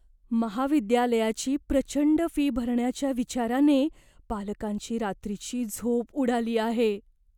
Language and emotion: Marathi, fearful